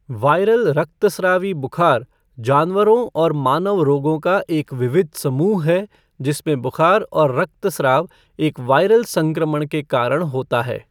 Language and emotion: Hindi, neutral